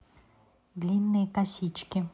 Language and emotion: Russian, neutral